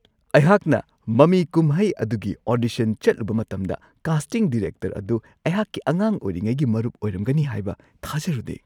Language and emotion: Manipuri, surprised